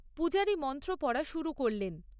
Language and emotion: Bengali, neutral